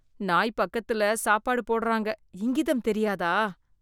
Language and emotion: Tamil, disgusted